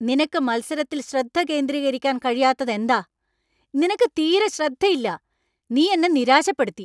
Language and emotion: Malayalam, angry